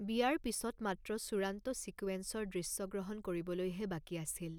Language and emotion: Assamese, neutral